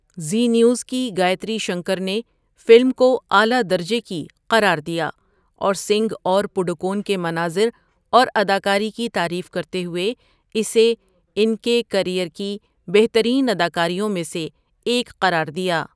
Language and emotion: Urdu, neutral